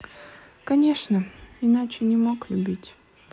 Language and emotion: Russian, sad